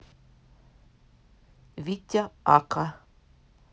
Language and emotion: Russian, neutral